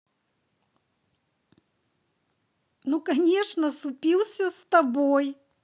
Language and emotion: Russian, positive